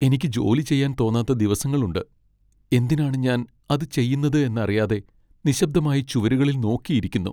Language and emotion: Malayalam, sad